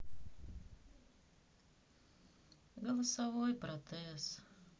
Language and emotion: Russian, sad